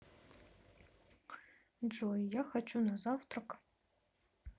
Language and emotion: Russian, neutral